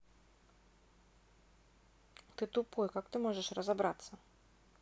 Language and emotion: Russian, neutral